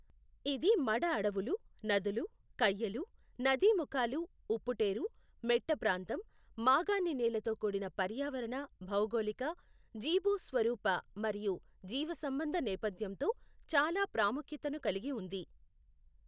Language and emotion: Telugu, neutral